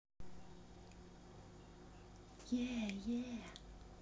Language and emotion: Russian, positive